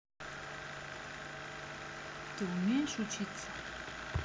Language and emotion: Russian, neutral